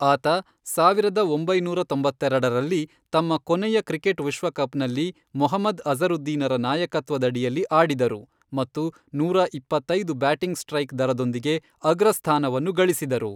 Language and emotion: Kannada, neutral